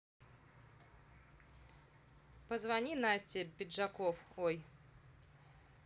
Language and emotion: Russian, neutral